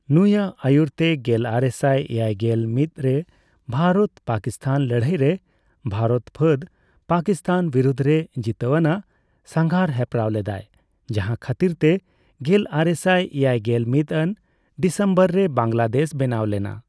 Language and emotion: Santali, neutral